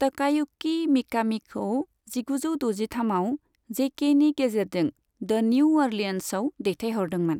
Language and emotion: Bodo, neutral